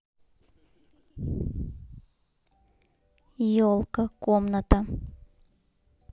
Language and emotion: Russian, neutral